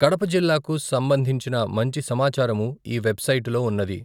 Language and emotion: Telugu, neutral